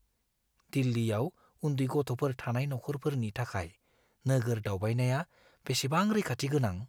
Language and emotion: Bodo, fearful